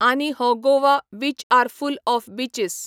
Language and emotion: Goan Konkani, neutral